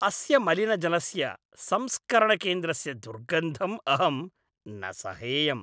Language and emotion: Sanskrit, disgusted